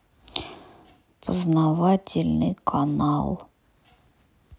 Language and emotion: Russian, sad